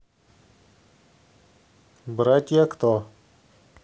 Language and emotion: Russian, neutral